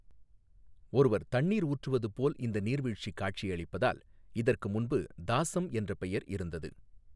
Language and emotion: Tamil, neutral